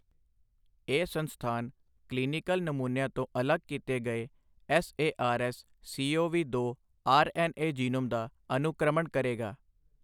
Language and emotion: Punjabi, neutral